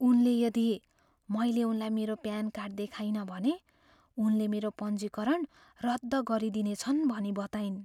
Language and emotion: Nepali, fearful